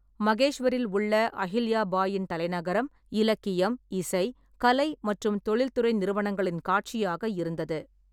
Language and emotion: Tamil, neutral